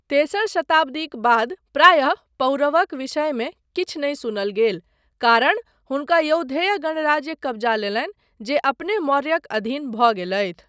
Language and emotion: Maithili, neutral